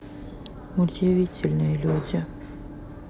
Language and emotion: Russian, sad